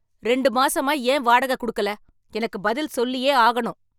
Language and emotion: Tamil, angry